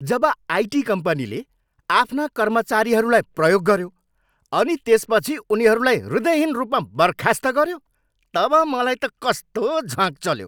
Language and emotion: Nepali, angry